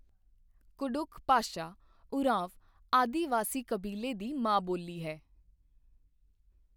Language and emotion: Punjabi, neutral